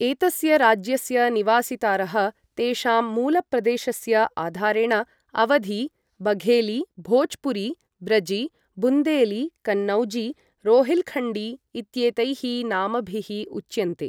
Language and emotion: Sanskrit, neutral